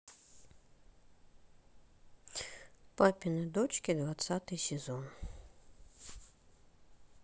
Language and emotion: Russian, neutral